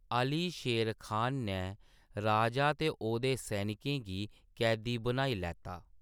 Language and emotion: Dogri, neutral